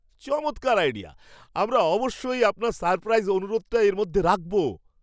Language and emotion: Bengali, surprised